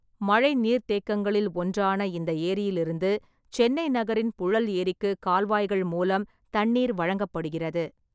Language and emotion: Tamil, neutral